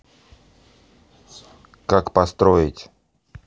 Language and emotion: Russian, neutral